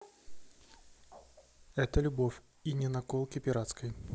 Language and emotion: Russian, neutral